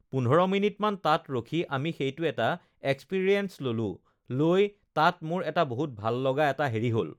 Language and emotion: Assamese, neutral